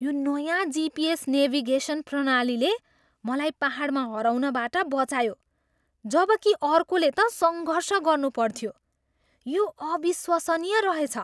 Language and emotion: Nepali, surprised